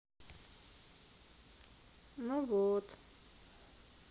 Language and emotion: Russian, sad